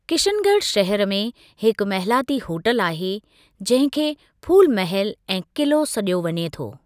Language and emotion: Sindhi, neutral